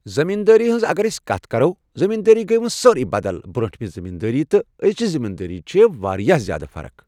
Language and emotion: Kashmiri, neutral